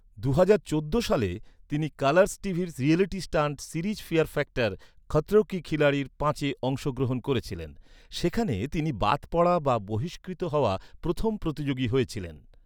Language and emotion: Bengali, neutral